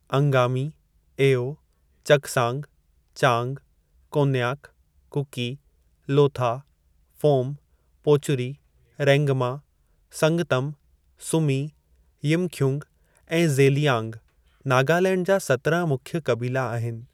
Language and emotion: Sindhi, neutral